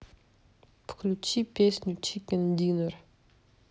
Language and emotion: Russian, neutral